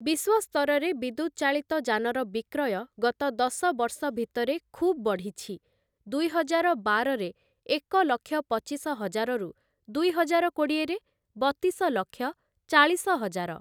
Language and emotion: Odia, neutral